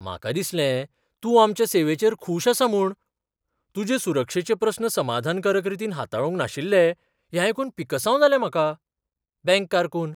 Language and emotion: Goan Konkani, surprised